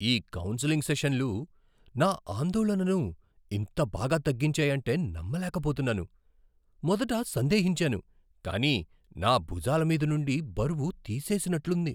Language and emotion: Telugu, surprised